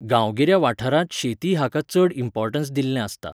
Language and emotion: Goan Konkani, neutral